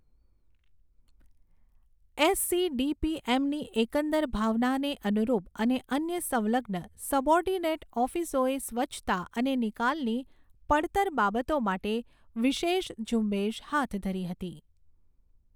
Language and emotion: Gujarati, neutral